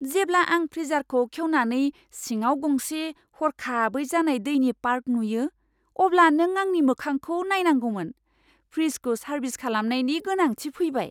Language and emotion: Bodo, surprised